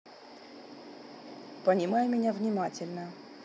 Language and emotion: Russian, neutral